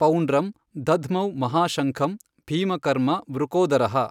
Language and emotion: Kannada, neutral